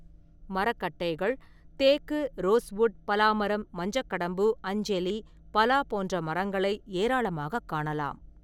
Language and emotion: Tamil, neutral